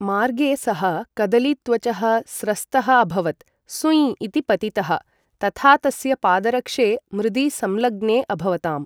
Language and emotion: Sanskrit, neutral